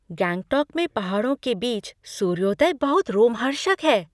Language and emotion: Hindi, surprised